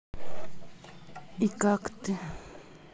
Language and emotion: Russian, sad